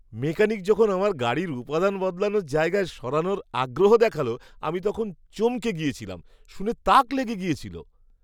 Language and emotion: Bengali, surprised